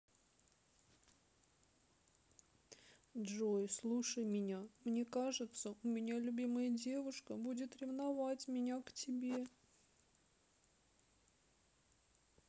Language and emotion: Russian, sad